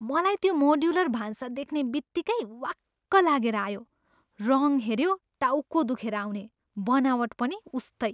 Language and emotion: Nepali, disgusted